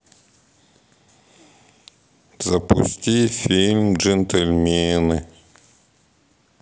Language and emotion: Russian, neutral